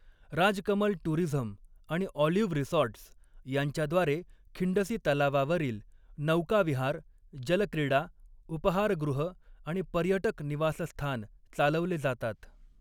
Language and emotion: Marathi, neutral